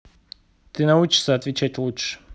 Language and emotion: Russian, angry